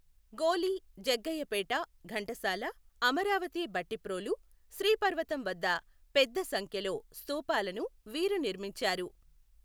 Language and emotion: Telugu, neutral